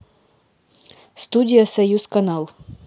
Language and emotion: Russian, neutral